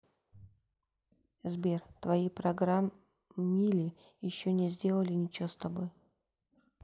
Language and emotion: Russian, neutral